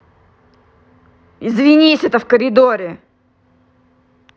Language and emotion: Russian, angry